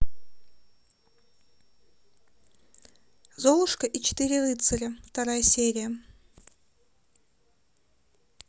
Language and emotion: Russian, neutral